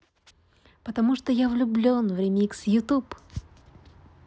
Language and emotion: Russian, positive